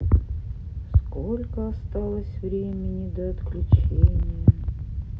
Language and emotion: Russian, sad